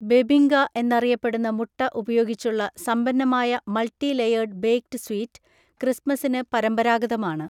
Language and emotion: Malayalam, neutral